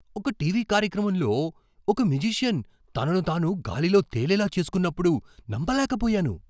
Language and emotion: Telugu, surprised